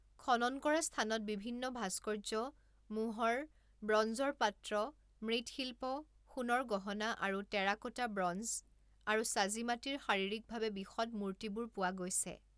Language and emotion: Assamese, neutral